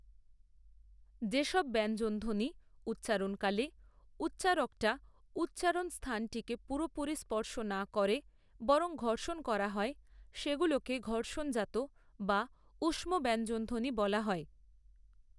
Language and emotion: Bengali, neutral